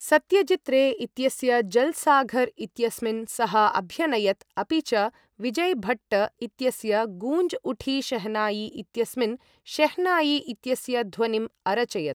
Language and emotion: Sanskrit, neutral